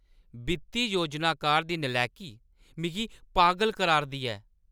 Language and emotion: Dogri, angry